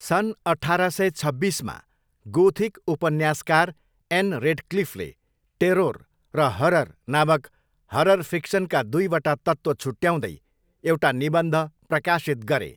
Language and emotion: Nepali, neutral